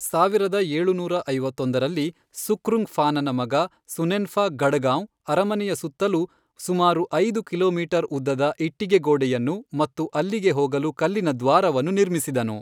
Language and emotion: Kannada, neutral